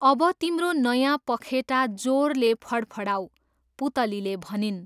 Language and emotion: Nepali, neutral